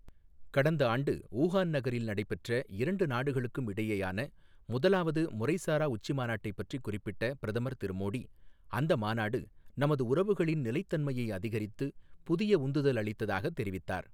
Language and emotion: Tamil, neutral